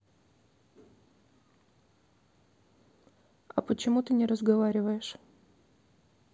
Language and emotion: Russian, neutral